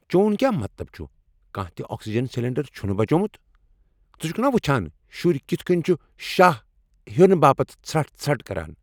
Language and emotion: Kashmiri, angry